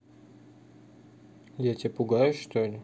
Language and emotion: Russian, neutral